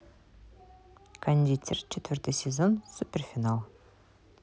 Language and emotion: Russian, positive